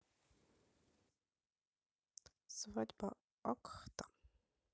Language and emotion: Russian, neutral